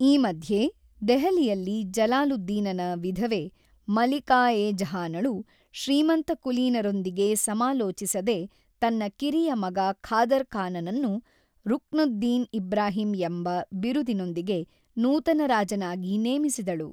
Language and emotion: Kannada, neutral